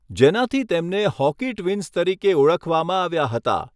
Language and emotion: Gujarati, neutral